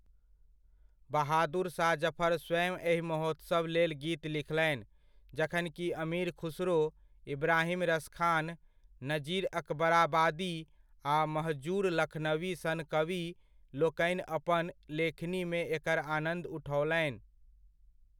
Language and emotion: Maithili, neutral